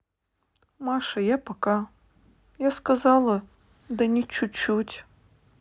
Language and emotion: Russian, sad